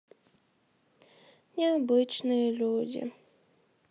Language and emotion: Russian, sad